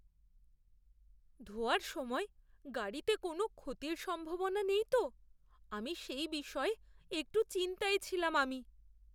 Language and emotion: Bengali, fearful